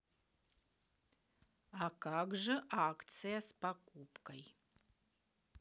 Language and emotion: Russian, neutral